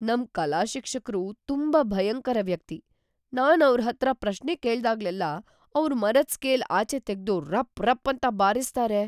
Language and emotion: Kannada, fearful